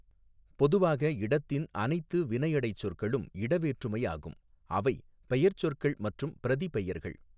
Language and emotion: Tamil, neutral